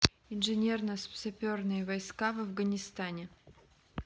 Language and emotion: Russian, neutral